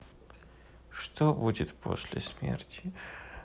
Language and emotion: Russian, sad